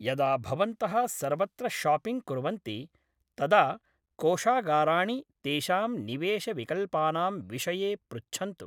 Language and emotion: Sanskrit, neutral